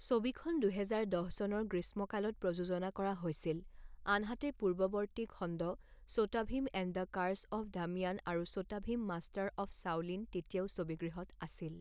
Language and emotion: Assamese, neutral